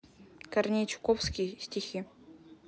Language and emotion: Russian, neutral